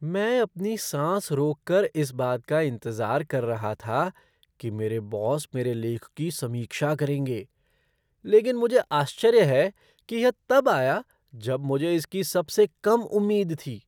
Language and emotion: Hindi, surprised